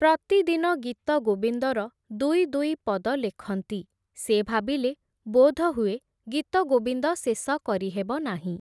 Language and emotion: Odia, neutral